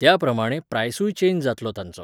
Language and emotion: Goan Konkani, neutral